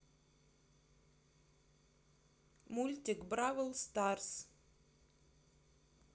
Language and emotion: Russian, neutral